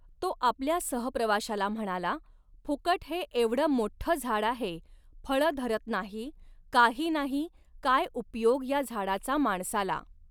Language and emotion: Marathi, neutral